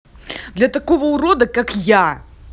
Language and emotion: Russian, angry